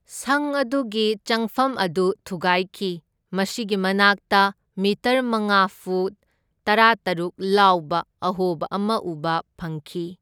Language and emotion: Manipuri, neutral